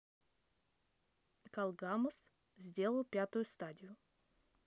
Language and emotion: Russian, neutral